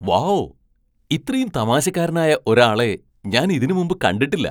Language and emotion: Malayalam, surprised